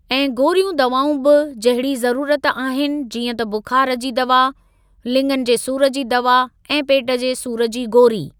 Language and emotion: Sindhi, neutral